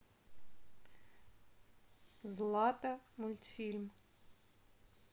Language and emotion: Russian, neutral